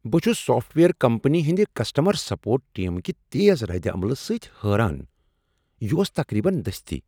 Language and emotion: Kashmiri, surprised